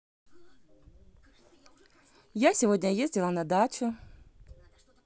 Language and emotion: Russian, positive